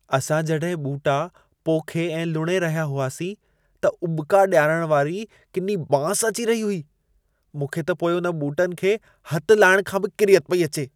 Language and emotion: Sindhi, disgusted